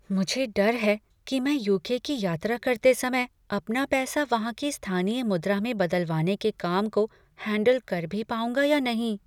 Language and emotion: Hindi, fearful